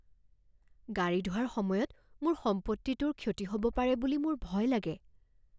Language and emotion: Assamese, fearful